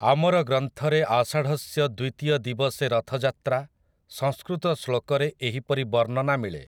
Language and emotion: Odia, neutral